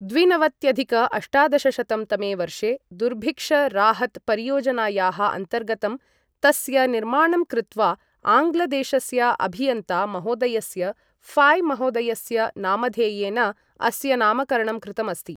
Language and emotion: Sanskrit, neutral